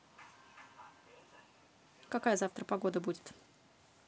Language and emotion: Russian, neutral